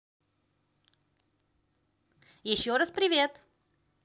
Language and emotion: Russian, positive